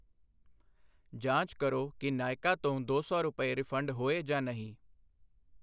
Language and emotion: Punjabi, neutral